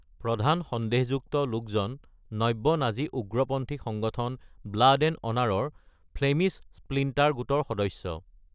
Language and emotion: Assamese, neutral